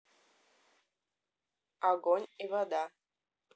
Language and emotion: Russian, neutral